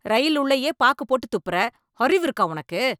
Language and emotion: Tamil, angry